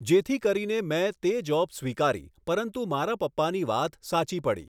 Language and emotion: Gujarati, neutral